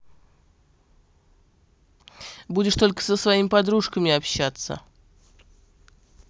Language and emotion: Russian, neutral